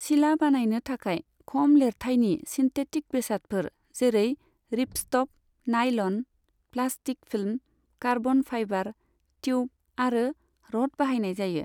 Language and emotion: Bodo, neutral